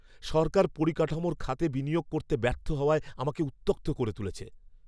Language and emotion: Bengali, angry